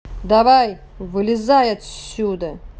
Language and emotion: Russian, angry